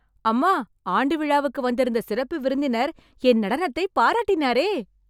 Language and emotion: Tamil, happy